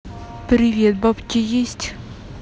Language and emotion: Russian, neutral